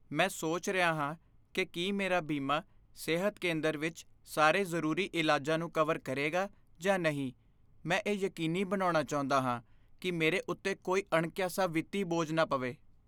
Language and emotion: Punjabi, fearful